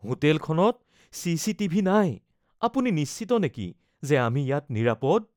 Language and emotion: Assamese, fearful